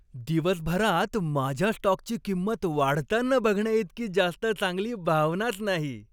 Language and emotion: Marathi, happy